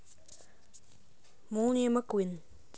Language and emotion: Russian, neutral